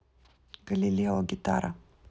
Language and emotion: Russian, neutral